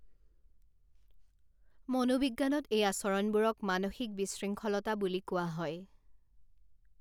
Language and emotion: Assamese, neutral